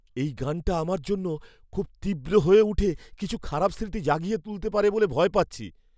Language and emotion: Bengali, fearful